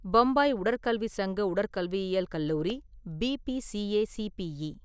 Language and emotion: Tamil, neutral